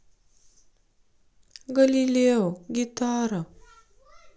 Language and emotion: Russian, sad